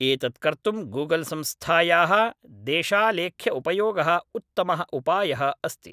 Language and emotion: Sanskrit, neutral